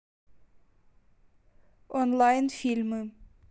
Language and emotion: Russian, neutral